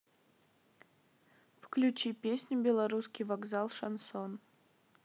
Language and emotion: Russian, neutral